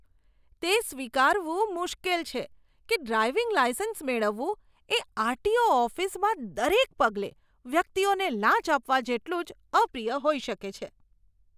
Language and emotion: Gujarati, disgusted